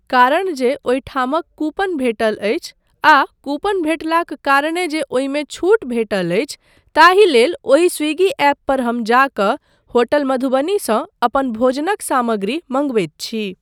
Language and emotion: Maithili, neutral